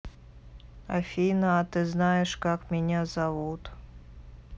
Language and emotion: Russian, neutral